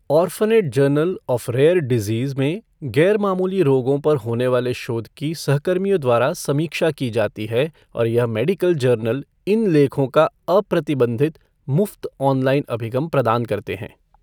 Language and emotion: Hindi, neutral